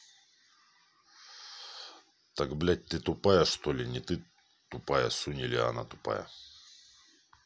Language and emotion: Russian, angry